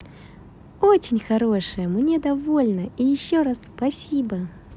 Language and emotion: Russian, positive